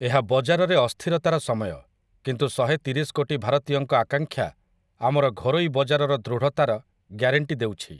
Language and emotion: Odia, neutral